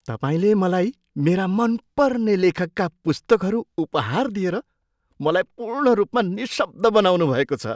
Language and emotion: Nepali, surprised